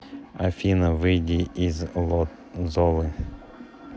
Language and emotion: Russian, neutral